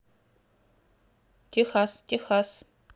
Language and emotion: Russian, neutral